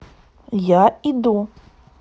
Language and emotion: Russian, positive